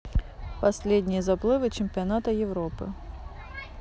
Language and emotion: Russian, neutral